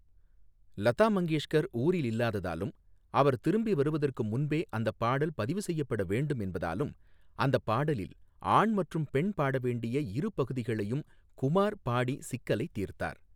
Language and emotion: Tamil, neutral